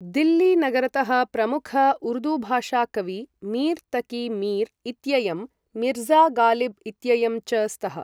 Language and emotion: Sanskrit, neutral